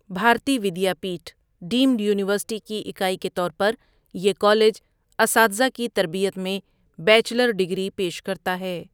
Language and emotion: Urdu, neutral